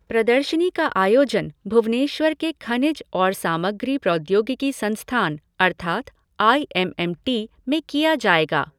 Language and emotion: Hindi, neutral